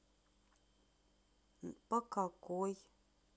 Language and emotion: Russian, sad